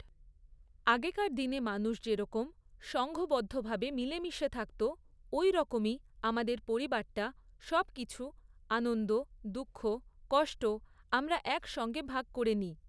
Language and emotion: Bengali, neutral